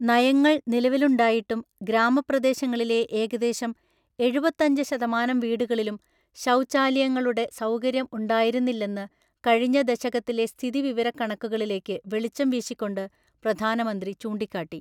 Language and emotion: Malayalam, neutral